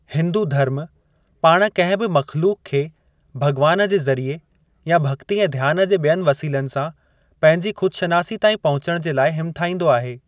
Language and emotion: Sindhi, neutral